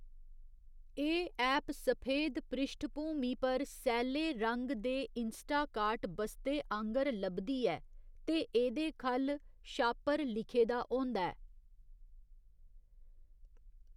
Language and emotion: Dogri, neutral